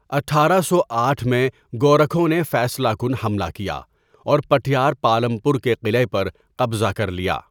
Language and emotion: Urdu, neutral